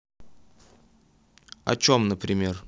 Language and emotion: Russian, neutral